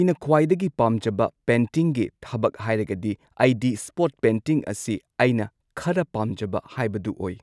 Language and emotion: Manipuri, neutral